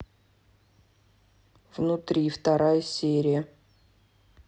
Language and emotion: Russian, neutral